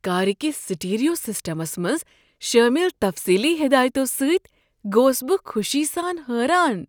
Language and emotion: Kashmiri, surprised